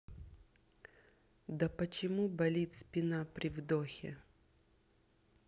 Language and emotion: Russian, neutral